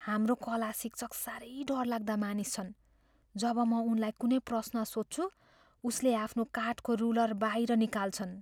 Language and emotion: Nepali, fearful